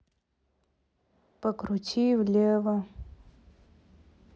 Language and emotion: Russian, neutral